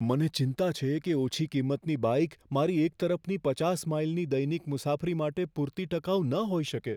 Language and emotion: Gujarati, fearful